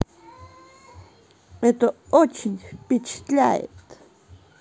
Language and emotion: Russian, positive